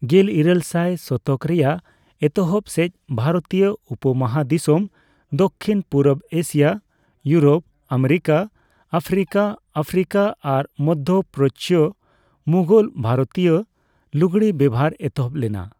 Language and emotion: Santali, neutral